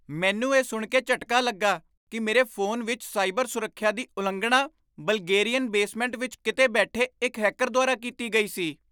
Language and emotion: Punjabi, surprised